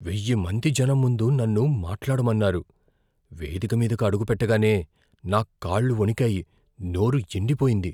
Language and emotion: Telugu, fearful